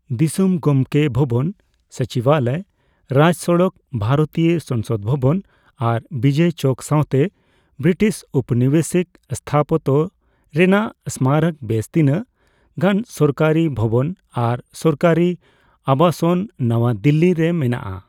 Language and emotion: Santali, neutral